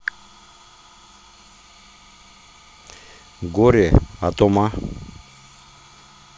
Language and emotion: Russian, neutral